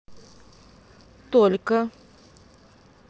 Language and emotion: Russian, neutral